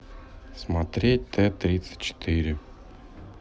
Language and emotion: Russian, neutral